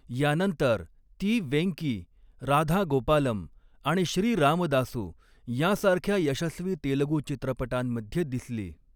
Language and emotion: Marathi, neutral